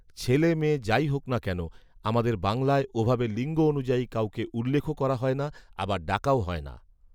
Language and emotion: Bengali, neutral